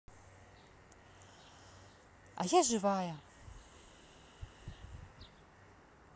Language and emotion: Russian, positive